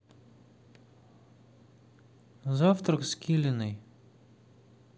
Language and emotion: Russian, neutral